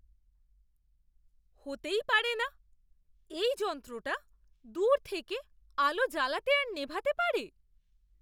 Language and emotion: Bengali, surprised